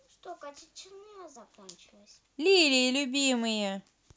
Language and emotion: Russian, neutral